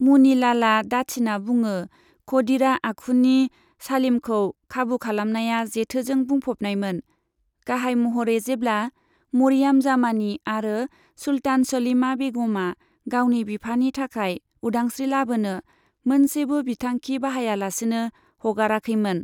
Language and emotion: Bodo, neutral